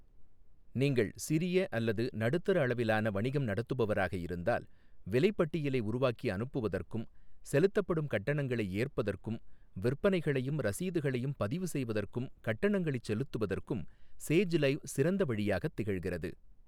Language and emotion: Tamil, neutral